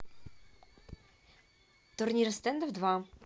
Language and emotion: Russian, neutral